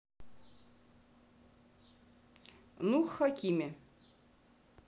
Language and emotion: Russian, neutral